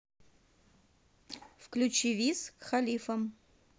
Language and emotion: Russian, neutral